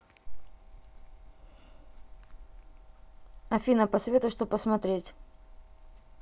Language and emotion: Russian, neutral